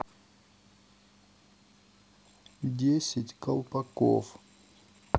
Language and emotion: Russian, neutral